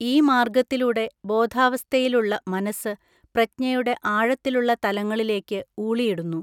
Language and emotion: Malayalam, neutral